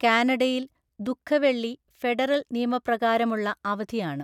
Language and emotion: Malayalam, neutral